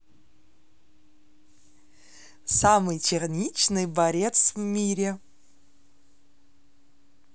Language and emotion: Russian, positive